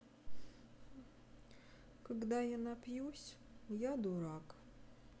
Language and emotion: Russian, sad